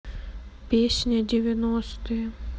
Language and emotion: Russian, sad